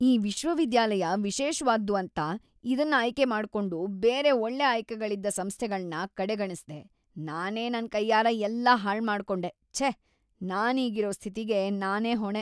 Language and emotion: Kannada, disgusted